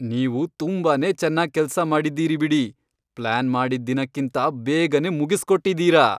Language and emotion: Kannada, happy